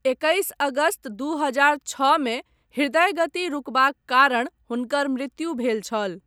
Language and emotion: Maithili, neutral